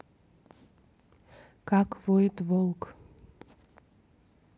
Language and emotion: Russian, neutral